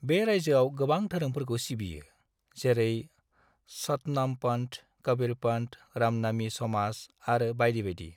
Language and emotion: Bodo, neutral